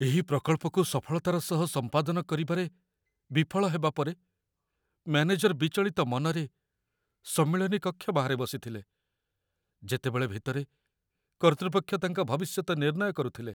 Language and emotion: Odia, fearful